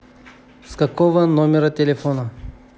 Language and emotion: Russian, neutral